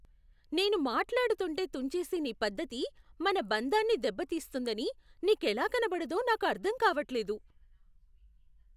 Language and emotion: Telugu, surprised